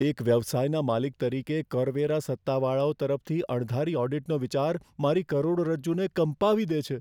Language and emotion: Gujarati, fearful